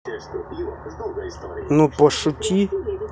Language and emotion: Russian, neutral